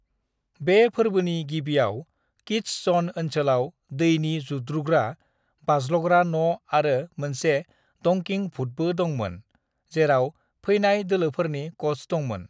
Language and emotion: Bodo, neutral